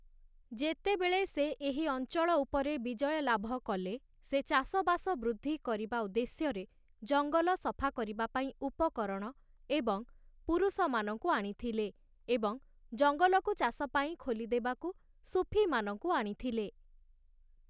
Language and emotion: Odia, neutral